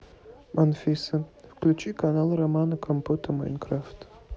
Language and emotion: Russian, neutral